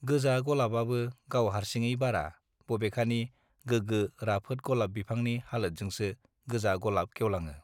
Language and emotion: Bodo, neutral